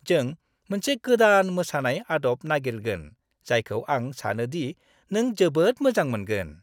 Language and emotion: Bodo, happy